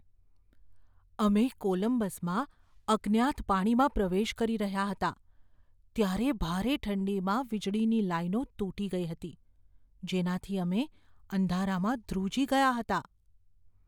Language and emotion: Gujarati, fearful